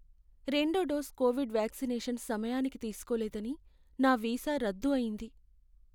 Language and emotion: Telugu, sad